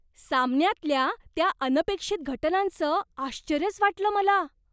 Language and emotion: Marathi, surprised